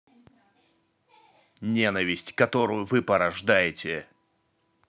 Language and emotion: Russian, angry